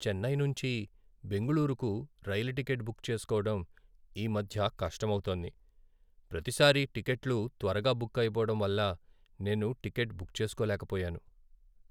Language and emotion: Telugu, sad